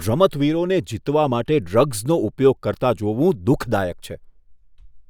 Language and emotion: Gujarati, disgusted